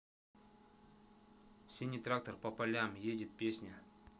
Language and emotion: Russian, neutral